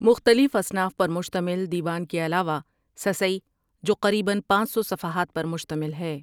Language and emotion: Urdu, neutral